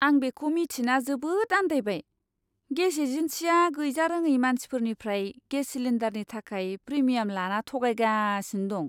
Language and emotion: Bodo, disgusted